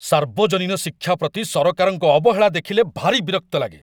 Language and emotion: Odia, angry